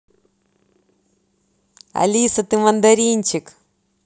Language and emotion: Russian, positive